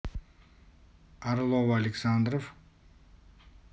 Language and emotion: Russian, neutral